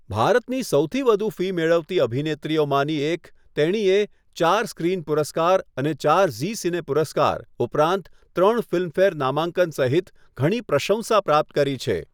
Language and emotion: Gujarati, neutral